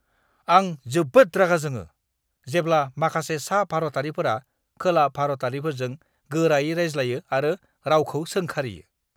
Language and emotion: Bodo, angry